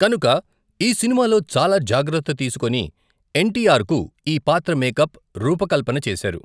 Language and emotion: Telugu, neutral